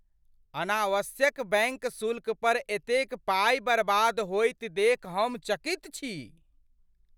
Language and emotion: Maithili, surprised